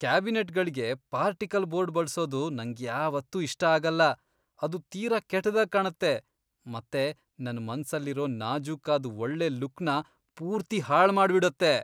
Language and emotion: Kannada, disgusted